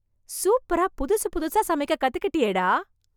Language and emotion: Tamil, surprised